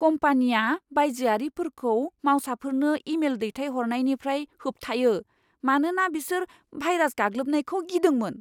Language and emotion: Bodo, fearful